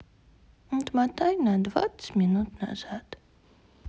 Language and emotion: Russian, sad